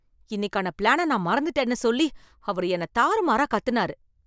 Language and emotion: Tamil, angry